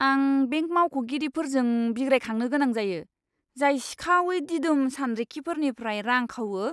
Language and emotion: Bodo, disgusted